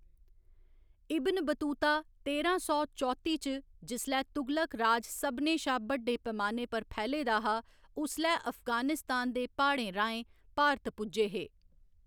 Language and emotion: Dogri, neutral